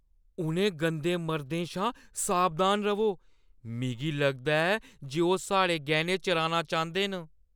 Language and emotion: Dogri, fearful